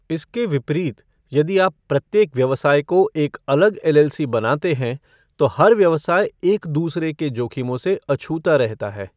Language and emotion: Hindi, neutral